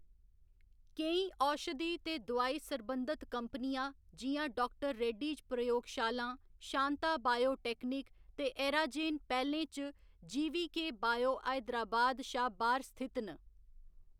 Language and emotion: Dogri, neutral